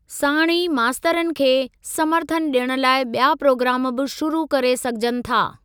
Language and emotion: Sindhi, neutral